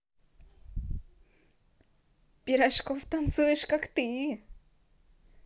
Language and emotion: Russian, positive